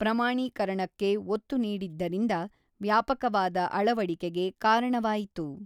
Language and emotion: Kannada, neutral